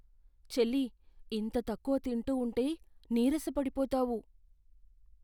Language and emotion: Telugu, fearful